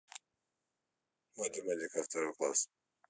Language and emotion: Russian, neutral